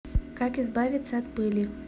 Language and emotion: Russian, neutral